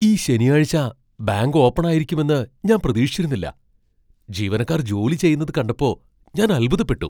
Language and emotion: Malayalam, surprised